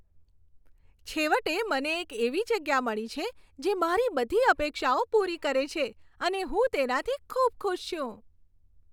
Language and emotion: Gujarati, happy